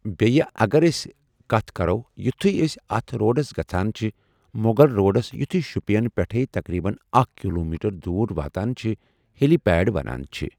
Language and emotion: Kashmiri, neutral